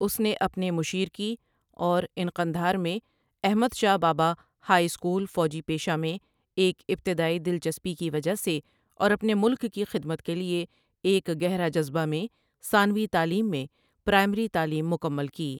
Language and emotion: Urdu, neutral